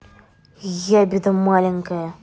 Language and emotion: Russian, angry